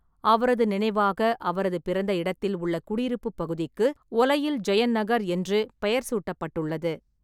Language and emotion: Tamil, neutral